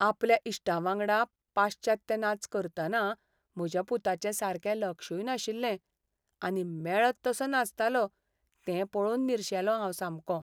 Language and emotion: Goan Konkani, sad